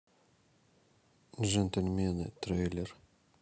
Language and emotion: Russian, neutral